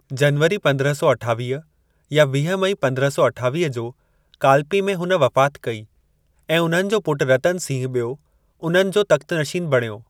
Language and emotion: Sindhi, neutral